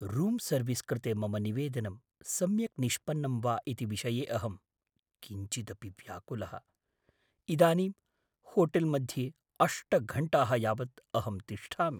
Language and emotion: Sanskrit, fearful